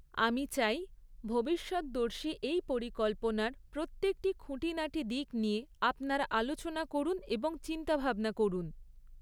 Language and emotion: Bengali, neutral